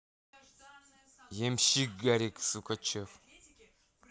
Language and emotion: Russian, angry